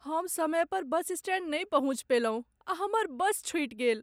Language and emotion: Maithili, sad